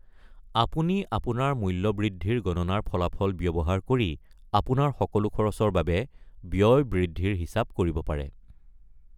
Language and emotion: Assamese, neutral